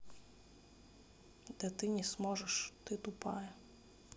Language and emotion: Russian, neutral